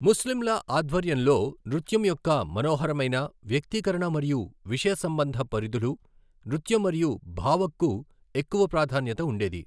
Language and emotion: Telugu, neutral